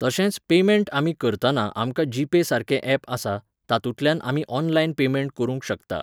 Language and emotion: Goan Konkani, neutral